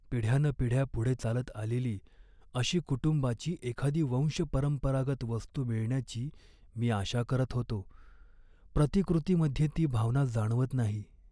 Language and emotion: Marathi, sad